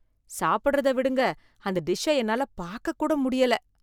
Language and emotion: Tamil, disgusted